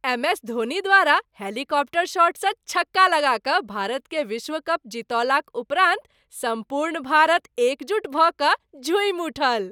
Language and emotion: Maithili, happy